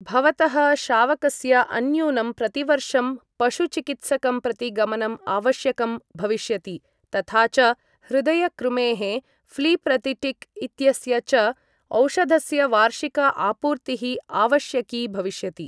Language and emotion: Sanskrit, neutral